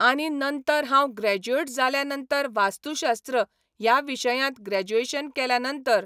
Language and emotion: Goan Konkani, neutral